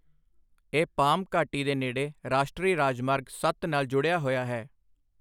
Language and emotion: Punjabi, neutral